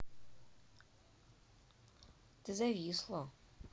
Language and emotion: Russian, neutral